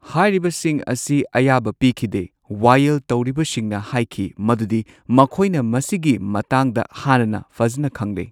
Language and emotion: Manipuri, neutral